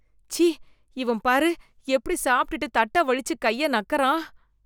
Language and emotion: Tamil, disgusted